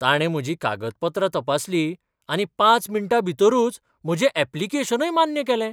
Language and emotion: Goan Konkani, surprised